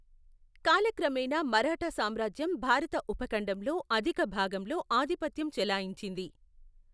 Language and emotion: Telugu, neutral